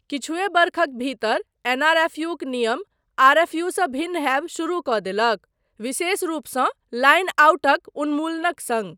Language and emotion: Maithili, neutral